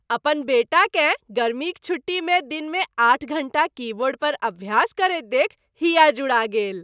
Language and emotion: Maithili, happy